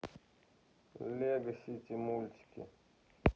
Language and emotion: Russian, neutral